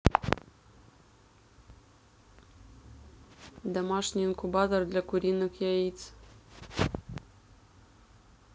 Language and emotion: Russian, neutral